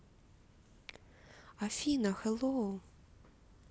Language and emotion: Russian, positive